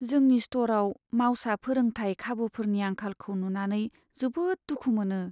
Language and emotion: Bodo, sad